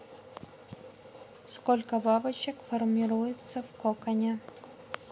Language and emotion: Russian, neutral